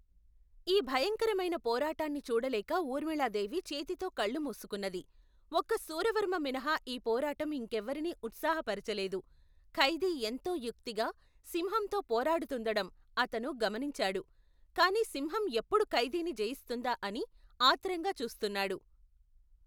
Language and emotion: Telugu, neutral